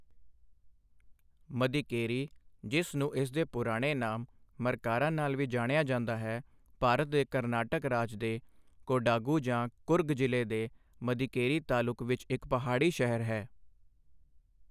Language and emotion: Punjabi, neutral